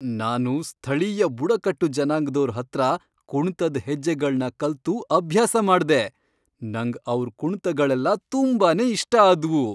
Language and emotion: Kannada, happy